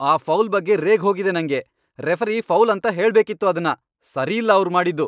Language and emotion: Kannada, angry